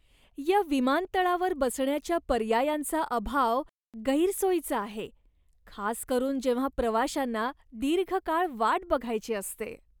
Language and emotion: Marathi, disgusted